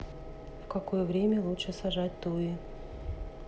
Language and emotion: Russian, neutral